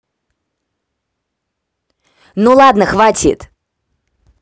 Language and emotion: Russian, angry